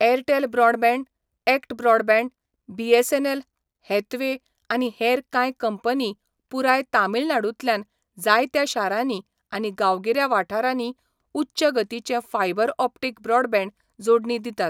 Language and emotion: Goan Konkani, neutral